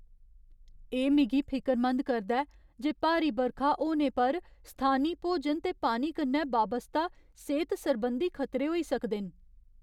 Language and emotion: Dogri, fearful